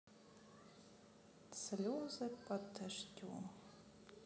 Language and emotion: Russian, sad